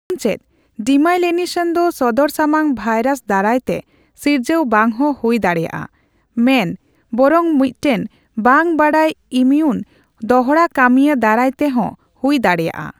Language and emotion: Santali, neutral